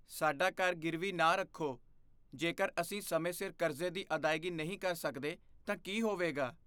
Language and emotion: Punjabi, fearful